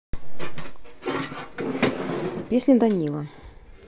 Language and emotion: Russian, neutral